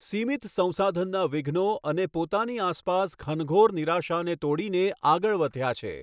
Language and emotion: Gujarati, neutral